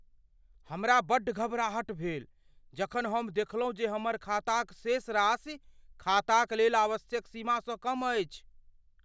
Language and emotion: Maithili, fearful